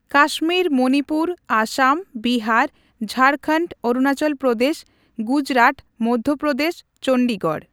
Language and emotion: Santali, neutral